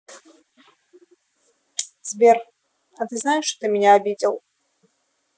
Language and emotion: Russian, sad